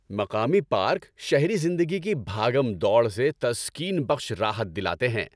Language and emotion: Urdu, happy